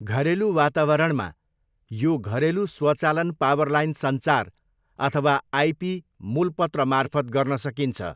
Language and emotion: Nepali, neutral